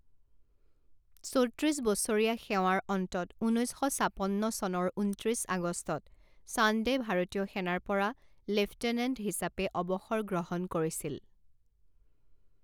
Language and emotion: Assamese, neutral